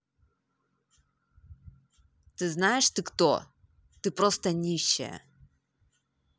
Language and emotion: Russian, angry